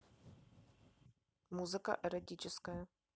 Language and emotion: Russian, neutral